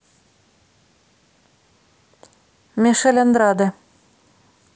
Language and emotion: Russian, neutral